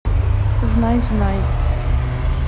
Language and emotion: Russian, neutral